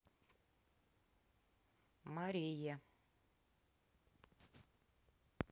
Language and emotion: Russian, neutral